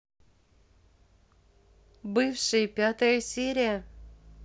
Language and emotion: Russian, positive